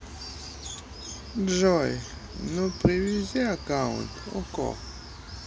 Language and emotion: Russian, sad